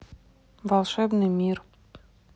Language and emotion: Russian, neutral